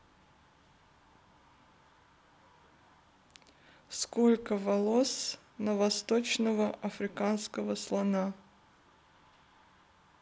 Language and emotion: Russian, neutral